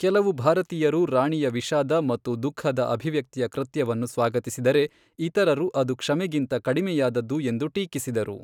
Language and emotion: Kannada, neutral